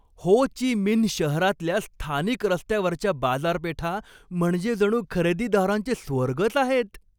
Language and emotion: Marathi, happy